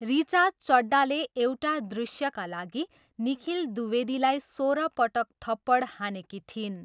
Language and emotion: Nepali, neutral